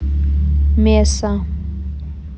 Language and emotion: Russian, neutral